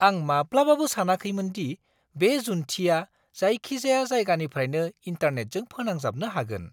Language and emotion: Bodo, surprised